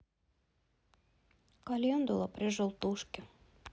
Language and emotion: Russian, sad